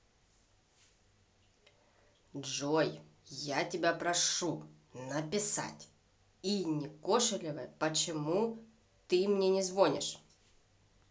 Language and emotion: Russian, angry